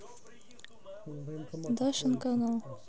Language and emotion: Russian, neutral